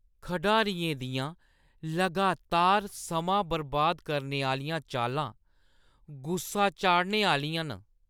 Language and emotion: Dogri, disgusted